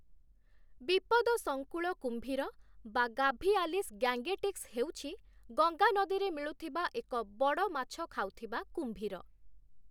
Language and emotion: Odia, neutral